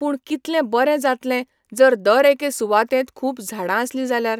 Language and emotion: Goan Konkani, neutral